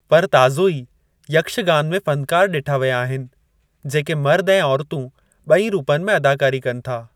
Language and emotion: Sindhi, neutral